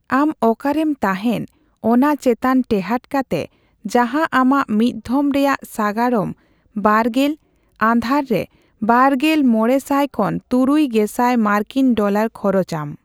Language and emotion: Santali, neutral